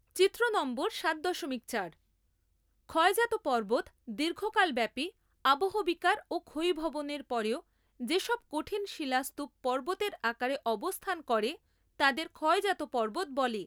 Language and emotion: Bengali, neutral